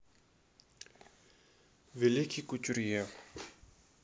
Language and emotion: Russian, neutral